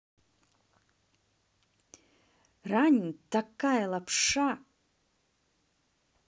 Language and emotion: Russian, angry